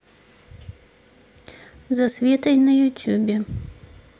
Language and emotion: Russian, neutral